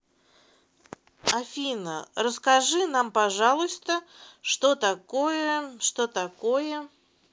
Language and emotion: Russian, neutral